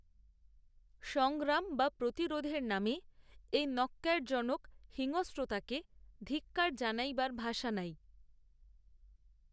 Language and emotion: Bengali, neutral